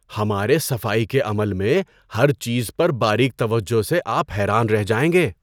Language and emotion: Urdu, surprised